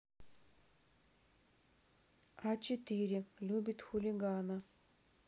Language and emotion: Russian, neutral